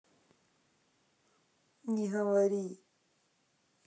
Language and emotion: Russian, neutral